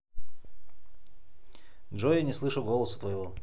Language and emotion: Russian, neutral